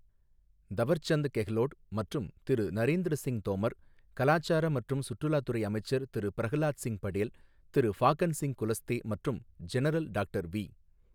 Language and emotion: Tamil, neutral